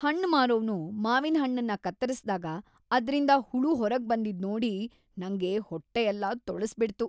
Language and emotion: Kannada, disgusted